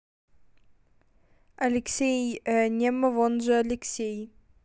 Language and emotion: Russian, neutral